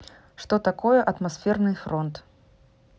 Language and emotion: Russian, neutral